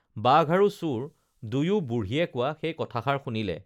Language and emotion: Assamese, neutral